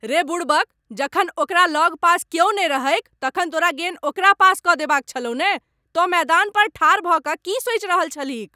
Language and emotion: Maithili, angry